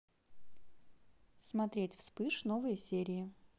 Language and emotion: Russian, neutral